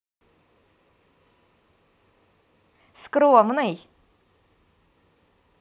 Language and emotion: Russian, positive